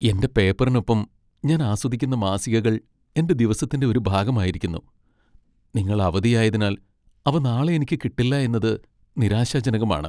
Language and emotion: Malayalam, sad